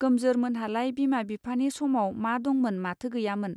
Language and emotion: Bodo, neutral